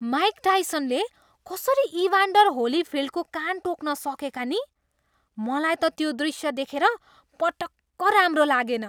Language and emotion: Nepali, disgusted